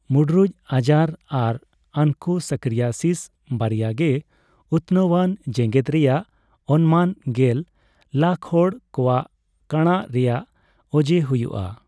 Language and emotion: Santali, neutral